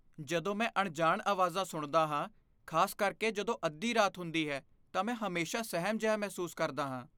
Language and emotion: Punjabi, fearful